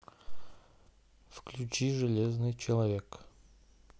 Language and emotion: Russian, neutral